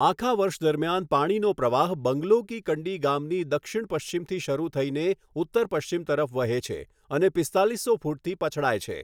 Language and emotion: Gujarati, neutral